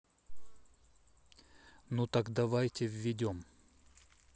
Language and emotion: Russian, neutral